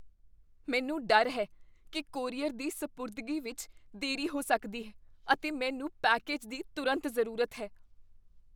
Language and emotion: Punjabi, fearful